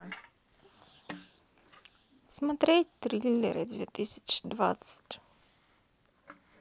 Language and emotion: Russian, sad